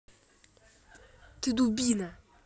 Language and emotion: Russian, angry